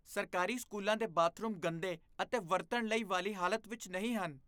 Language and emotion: Punjabi, disgusted